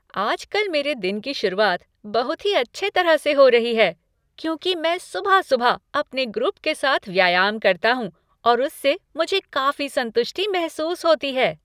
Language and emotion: Hindi, happy